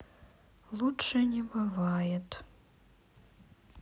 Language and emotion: Russian, sad